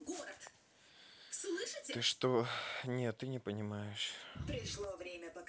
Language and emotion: Russian, sad